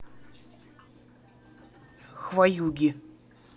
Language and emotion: Russian, angry